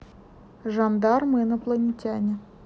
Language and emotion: Russian, neutral